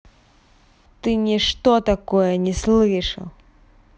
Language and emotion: Russian, angry